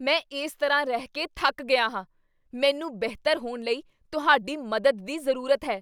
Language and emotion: Punjabi, angry